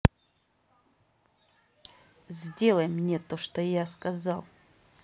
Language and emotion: Russian, angry